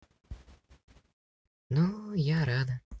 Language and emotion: Russian, sad